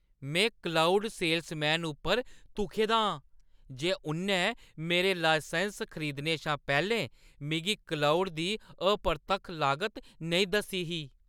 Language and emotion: Dogri, angry